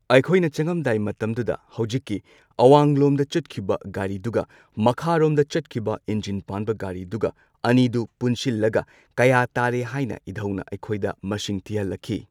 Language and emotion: Manipuri, neutral